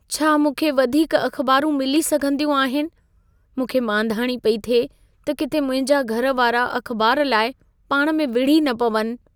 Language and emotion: Sindhi, fearful